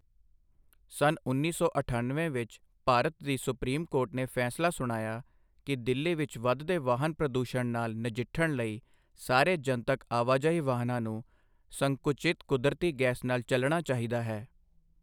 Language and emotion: Punjabi, neutral